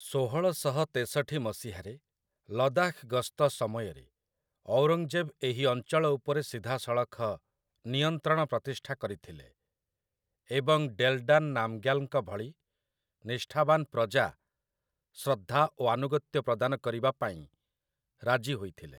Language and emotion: Odia, neutral